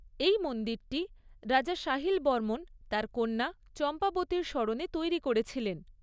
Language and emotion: Bengali, neutral